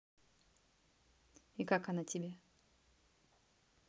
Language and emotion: Russian, neutral